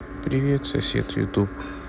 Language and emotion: Russian, sad